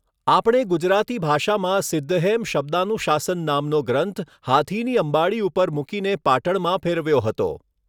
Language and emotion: Gujarati, neutral